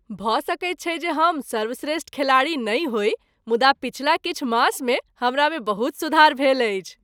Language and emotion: Maithili, happy